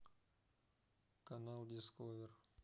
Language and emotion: Russian, neutral